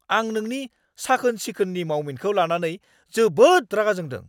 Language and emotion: Bodo, angry